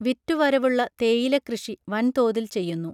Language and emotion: Malayalam, neutral